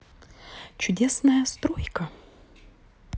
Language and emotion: Russian, neutral